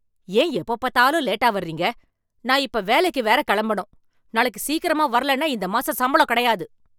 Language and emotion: Tamil, angry